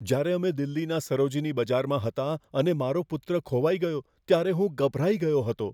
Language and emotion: Gujarati, fearful